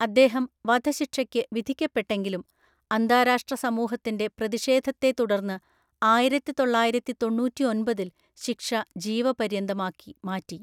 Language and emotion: Malayalam, neutral